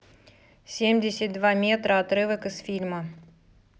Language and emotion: Russian, neutral